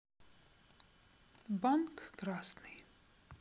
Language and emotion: Russian, neutral